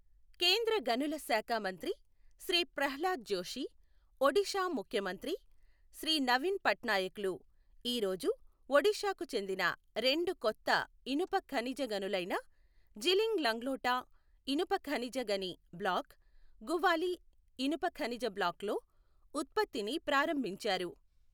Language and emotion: Telugu, neutral